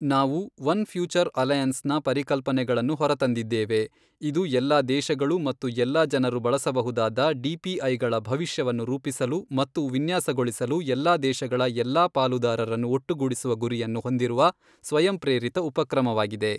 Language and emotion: Kannada, neutral